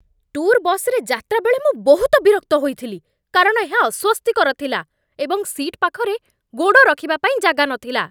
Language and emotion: Odia, angry